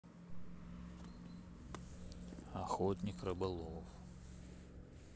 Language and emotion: Russian, neutral